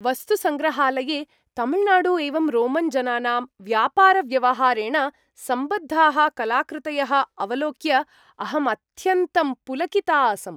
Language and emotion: Sanskrit, happy